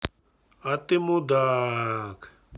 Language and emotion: Russian, angry